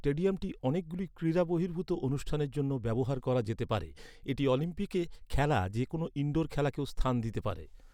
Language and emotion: Bengali, neutral